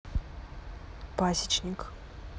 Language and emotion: Russian, neutral